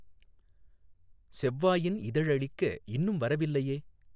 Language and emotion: Tamil, neutral